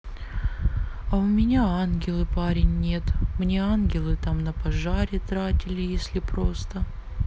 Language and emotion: Russian, sad